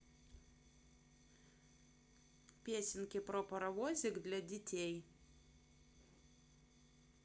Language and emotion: Russian, positive